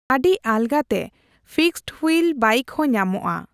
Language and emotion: Santali, neutral